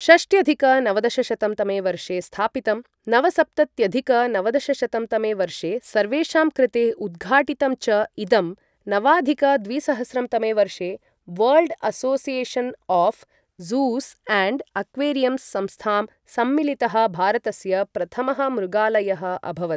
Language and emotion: Sanskrit, neutral